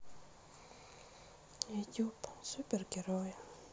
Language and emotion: Russian, sad